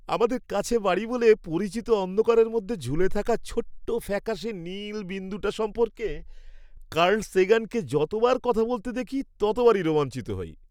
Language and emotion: Bengali, happy